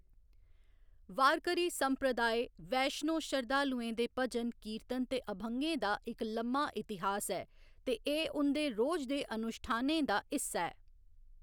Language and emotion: Dogri, neutral